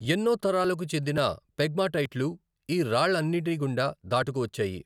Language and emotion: Telugu, neutral